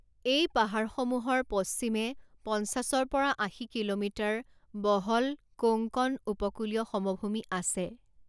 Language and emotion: Assamese, neutral